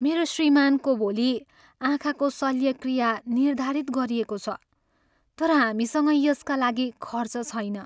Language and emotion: Nepali, sad